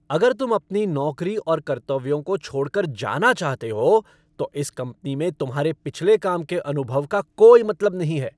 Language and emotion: Hindi, angry